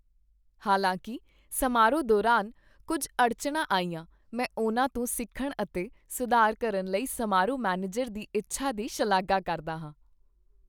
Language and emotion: Punjabi, happy